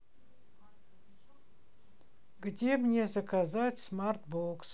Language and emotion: Russian, neutral